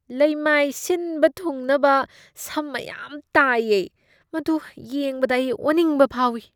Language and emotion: Manipuri, disgusted